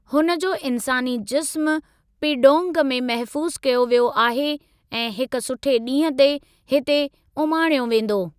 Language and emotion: Sindhi, neutral